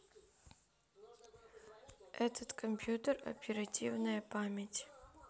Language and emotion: Russian, neutral